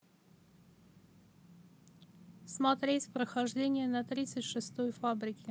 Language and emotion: Russian, neutral